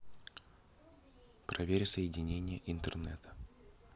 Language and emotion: Russian, neutral